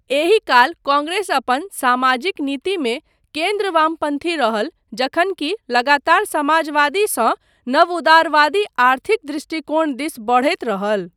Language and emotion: Maithili, neutral